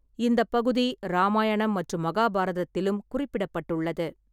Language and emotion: Tamil, neutral